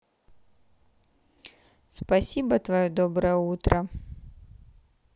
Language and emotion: Russian, neutral